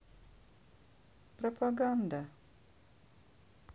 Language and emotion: Russian, sad